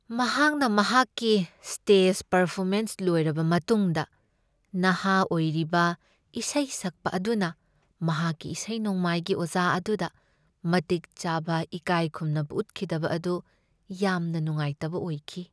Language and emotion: Manipuri, sad